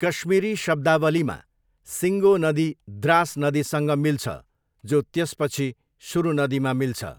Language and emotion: Nepali, neutral